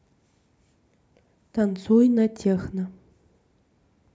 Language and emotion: Russian, neutral